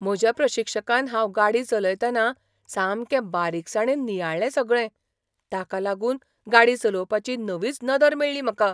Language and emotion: Goan Konkani, surprised